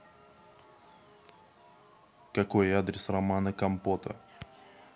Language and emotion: Russian, neutral